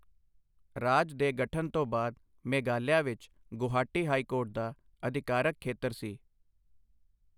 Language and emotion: Punjabi, neutral